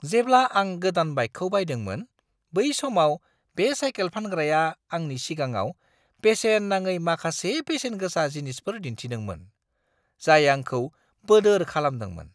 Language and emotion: Bodo, surprised